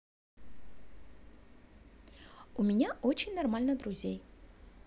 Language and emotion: Russian, positive